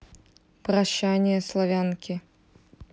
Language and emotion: Russian, neutral